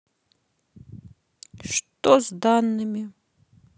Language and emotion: Russian, sad